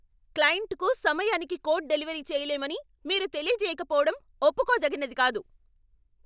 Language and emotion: Telugu, angry